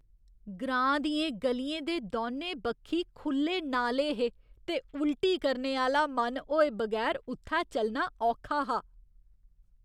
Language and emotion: Dogri, disgusted